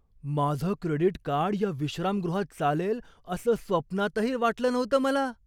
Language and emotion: Marathi, surprised